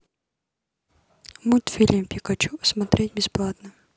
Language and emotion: Russian, neutral